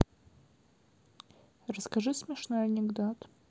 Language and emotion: Russian, neutral